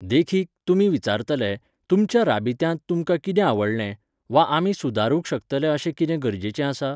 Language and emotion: Goan Konkani, neutral